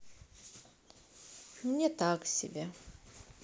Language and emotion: Russian, sad